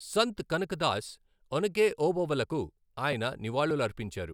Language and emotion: Telugu, neutral